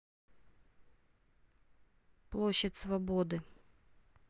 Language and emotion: Russian, neutral